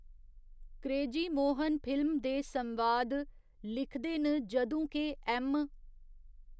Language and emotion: Dogri, neutral